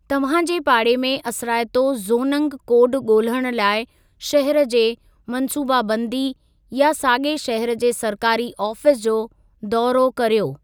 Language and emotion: Sindhi, neutral